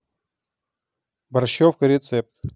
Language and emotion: Russian, neutral